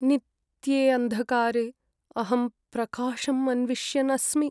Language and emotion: Sanskrit, sad